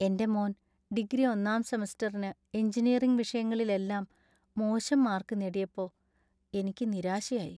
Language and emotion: Malayalam, sad